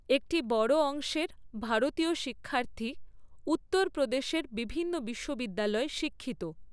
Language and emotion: Bengali, neutral